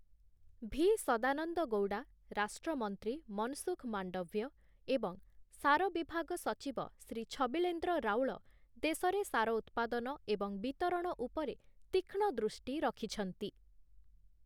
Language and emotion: Odia, neutral